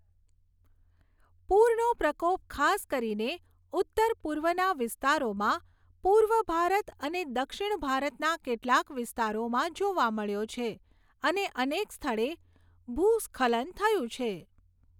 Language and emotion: Gujarati, neutral